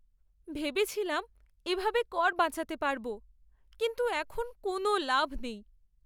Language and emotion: Bengali, sad